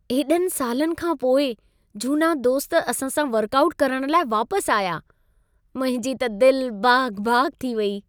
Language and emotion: Sindhi, happy